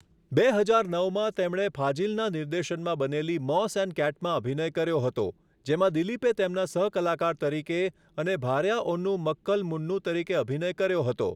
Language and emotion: Gujarati, neutral